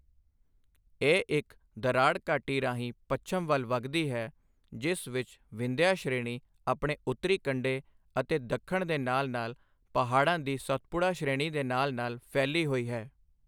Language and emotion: Punjabi, neutral